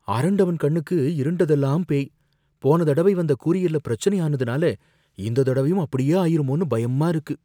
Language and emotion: Tamil, fearful